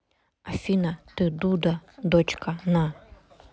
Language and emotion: Russian, neutral